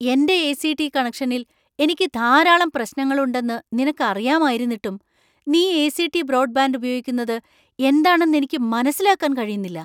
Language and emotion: Malayalam, surprised